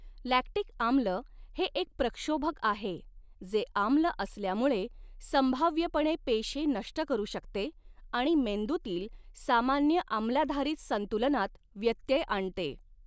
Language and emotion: Marathi, neutral